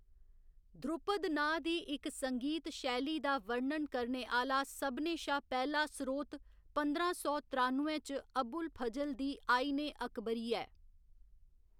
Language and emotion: Dogri, neutral